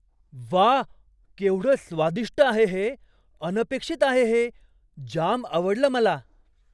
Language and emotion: Marathi, surprised